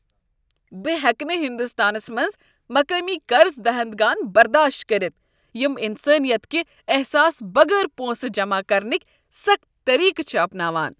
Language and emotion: Kashmiri, disgusted